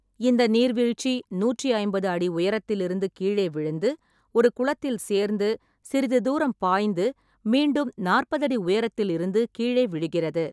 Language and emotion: Tamil, neutral